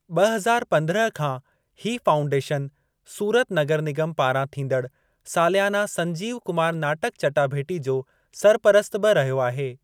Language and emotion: Sindhi, neutral